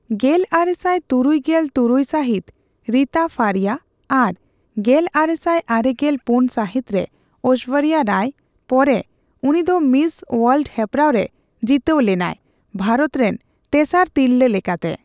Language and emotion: Santali, neutral